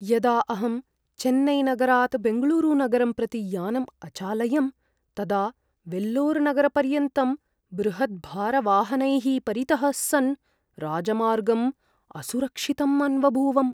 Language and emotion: Sanskrit, fearful